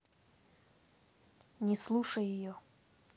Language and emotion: Russian, neutral